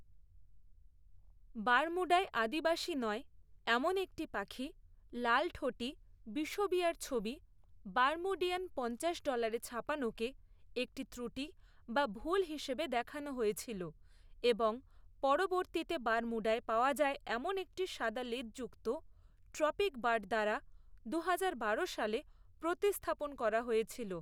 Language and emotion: Bengali, neutral